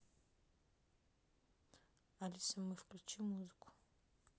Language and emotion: Russian, neutral